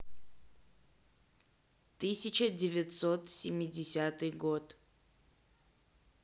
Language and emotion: Russian, neutral